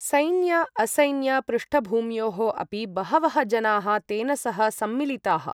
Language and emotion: Sanskrit, neutral